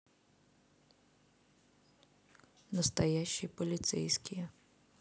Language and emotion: Russian, neutral